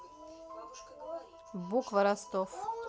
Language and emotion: Russian, neutral